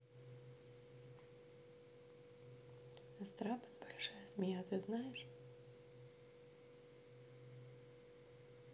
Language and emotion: Russian, neutral